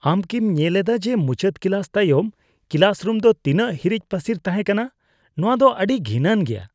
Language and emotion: Santali, disgusted